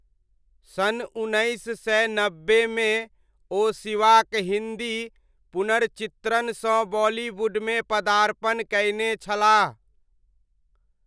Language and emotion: Maithili, neutral